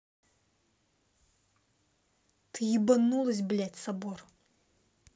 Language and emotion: Russian, angry